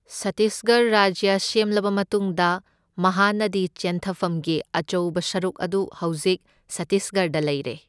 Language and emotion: Manipuri, neutral